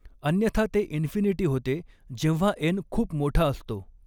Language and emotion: Marathi, neutral